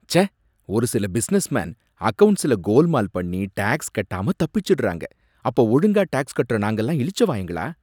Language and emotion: Tamil, disgusted